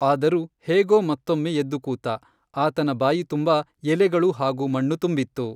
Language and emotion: Kannada, neutral